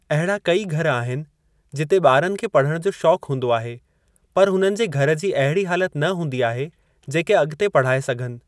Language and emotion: Sindhi, neutral